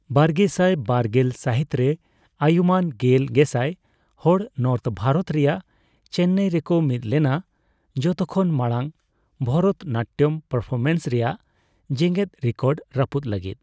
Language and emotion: Santali, neutral